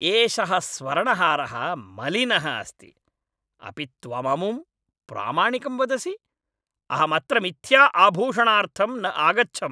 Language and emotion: Sanskrit, angry